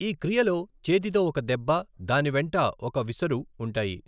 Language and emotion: Telugu, neutral